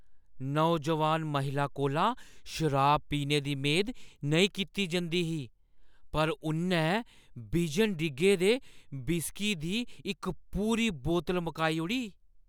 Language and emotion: Dogri, surprised